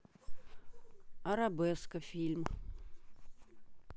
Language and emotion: Russian, neutral